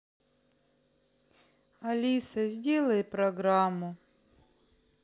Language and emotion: Russian, sad